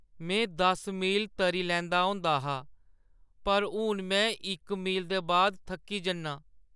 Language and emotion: Dogri, sad